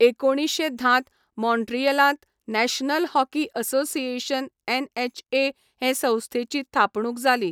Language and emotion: Goan Konkani, neutral